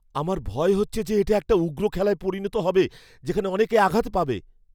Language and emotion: Bengali, fearful